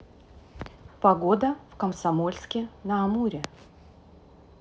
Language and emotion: Russian, neutral